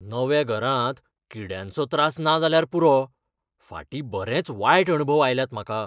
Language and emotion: Goan Konkani, fearful